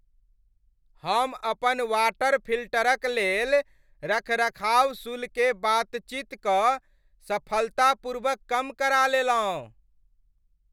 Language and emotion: Maithili, happy